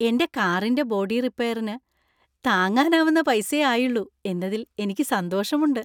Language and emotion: Malayalam, happy